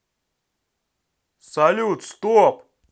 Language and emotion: Russian, neutral